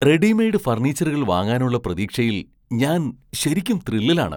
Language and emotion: Malayalam, surprised